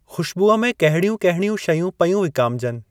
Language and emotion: Sindhi, neutral